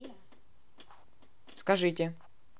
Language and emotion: Russian, neutral